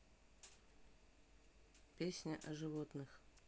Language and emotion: Russian, neutral